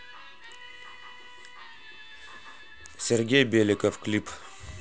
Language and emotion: Russian, neutral